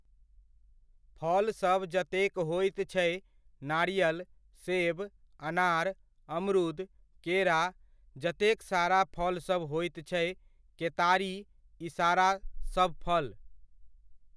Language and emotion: Maithili, neutral